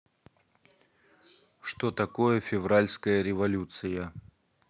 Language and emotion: Russian, neutral